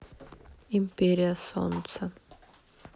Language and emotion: Russian, sad